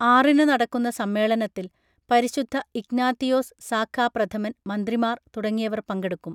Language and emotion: Malayalam, neutral